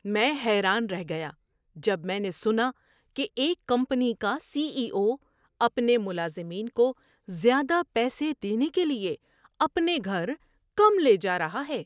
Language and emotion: Urdu, surprised